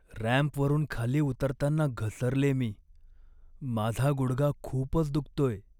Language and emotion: Marathi, sad